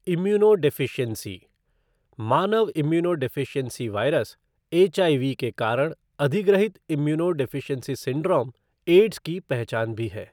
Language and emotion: Hindi, neutral